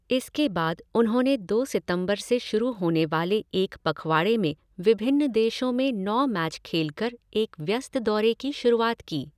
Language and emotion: Hindi, neutral